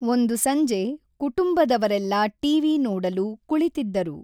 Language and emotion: Kannada, neutral